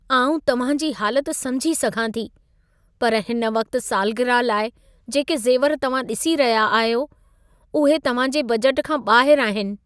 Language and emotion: Sindhi, sad